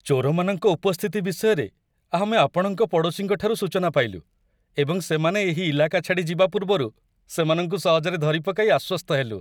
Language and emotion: Odia, happy